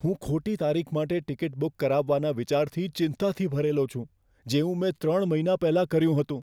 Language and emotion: Gujarati, fearful